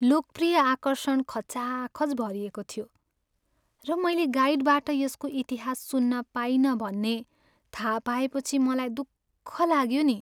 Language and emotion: Nepali, sad